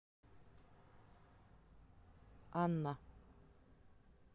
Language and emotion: Russian, neutral